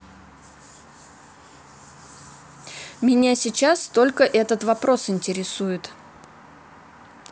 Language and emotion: Russian, neutral